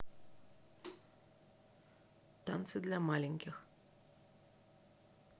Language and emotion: Russian, neutral